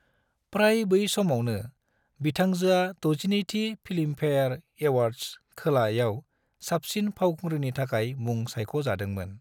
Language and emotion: Bodo, neutral